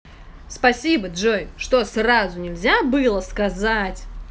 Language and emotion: Russian, angry